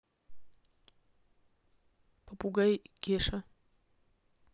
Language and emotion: Russian, neutral